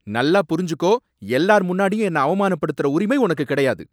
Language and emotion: Tamil, angry